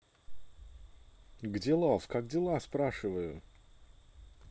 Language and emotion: Russian, positive